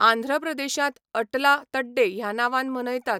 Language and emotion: Goan Konkani, neutral